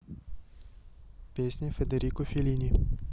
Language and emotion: Russian, neutral